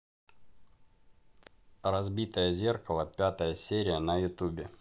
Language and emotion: Russian, neutral